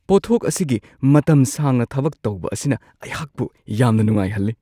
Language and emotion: Manipuri, surprised